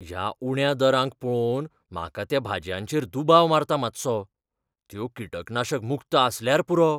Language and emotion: Goan Konkani, fearful